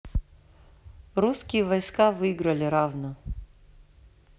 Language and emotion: Russian, neutral